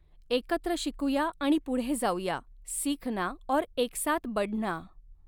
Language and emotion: Marathi, neutral